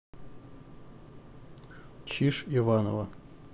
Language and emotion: Russian, neutral